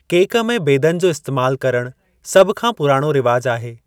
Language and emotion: Sindhi, neutral